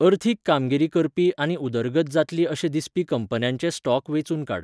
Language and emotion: Goan Konkani, neutral